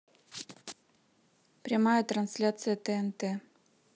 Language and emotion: Russian, neutral